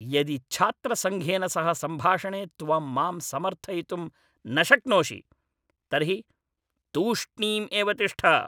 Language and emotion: Sanskrit, angry